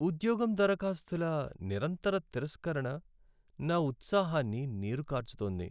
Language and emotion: Telugu, sad